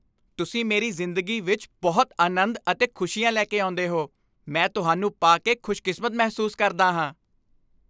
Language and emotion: Punjabi, happy